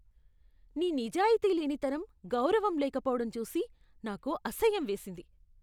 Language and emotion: Telugu, disgusted